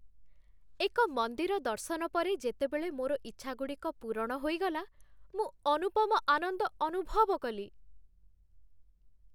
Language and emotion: Odia, happy